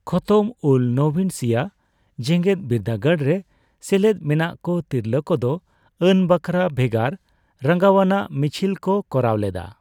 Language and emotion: Santali, neutral